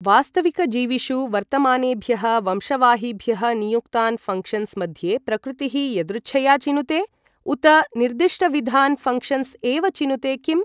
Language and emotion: Sanskrit, neutral